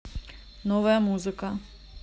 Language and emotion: Russian, neutral